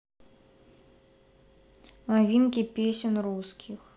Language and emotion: Russian, neutral